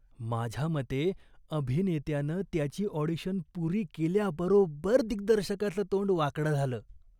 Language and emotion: Marathi, disgusted